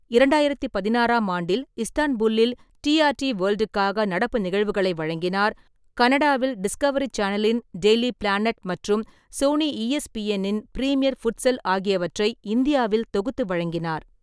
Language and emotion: Tamil, neutral